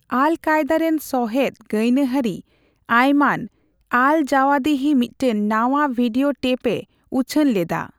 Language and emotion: Santali, neutral